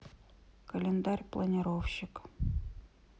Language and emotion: Russian, neutral